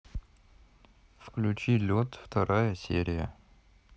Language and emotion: Russian, neutral